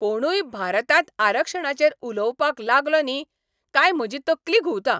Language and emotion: Goan Konkani, angry